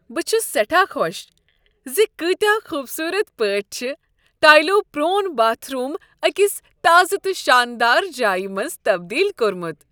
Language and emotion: Kashmiri, happy